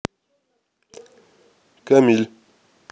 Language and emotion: Russian, neutral